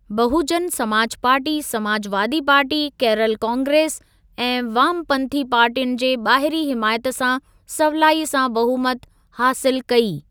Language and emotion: Sindhi, neutral